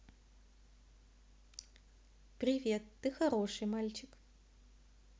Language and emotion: Russian, positive